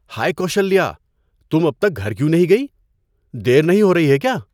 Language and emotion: Urdu, surprised